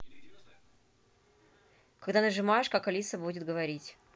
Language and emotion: Russian, neutral